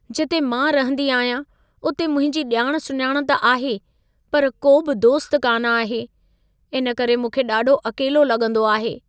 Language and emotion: Sindhi, sad